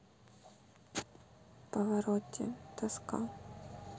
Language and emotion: Russian, sad